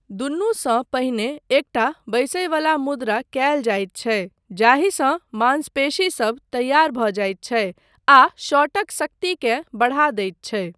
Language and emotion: Maithili, neutral